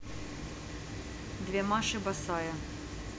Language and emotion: Russian, neutral